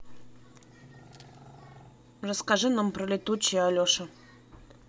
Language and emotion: Russian, neutral